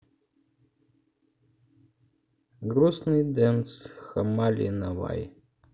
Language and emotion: Russian, sad